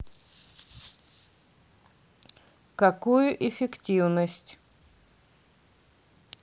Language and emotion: Russian, neutral